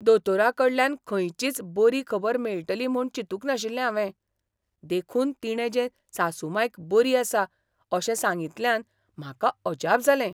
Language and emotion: Goan Konkani, surprised